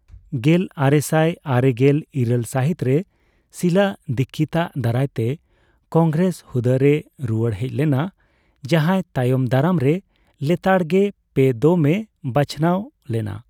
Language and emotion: Santali, neutral